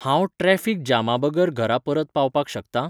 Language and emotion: Goan Konkani, neutral